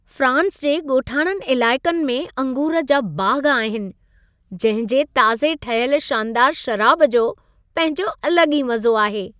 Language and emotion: Sindhi, happy